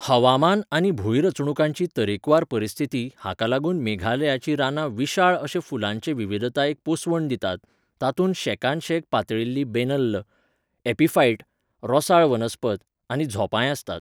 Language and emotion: Goan Konkani, neutral